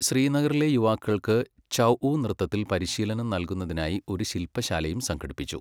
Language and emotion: Malayalam, neutral